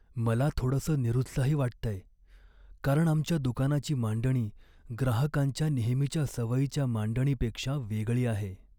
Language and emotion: Marathi, sad